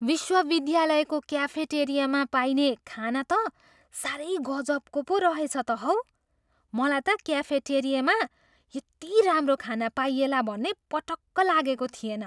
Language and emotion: Nepali, surprised